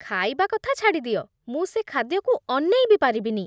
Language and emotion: Odia, disgusted